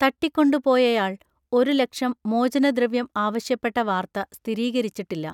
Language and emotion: Malayalam, neutral